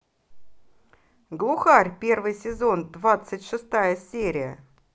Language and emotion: Russian, positive